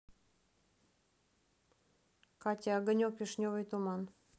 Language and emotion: Russian, neutral